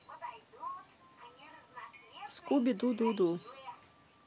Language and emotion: Russian, neutral